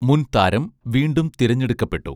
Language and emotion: Malayalam, neutral